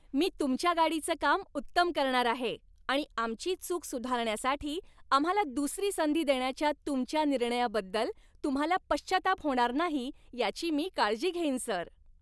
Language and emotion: Marathi, happy